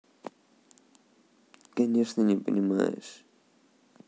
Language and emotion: Russian, sad